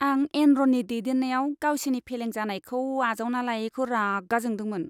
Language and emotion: Bodo, disgusted